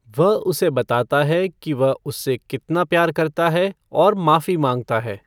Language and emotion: Hindi, neutral